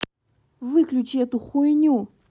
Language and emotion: Russian, angry